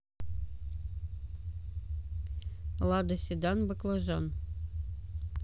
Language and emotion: Russian, neutral